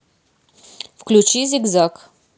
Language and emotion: Russian, neutral